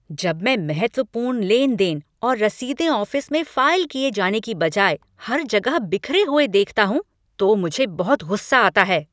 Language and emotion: Hindi, angry